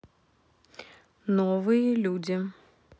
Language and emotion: Russian, neutral